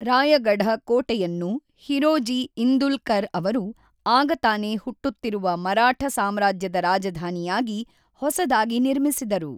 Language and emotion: Kannada, neutral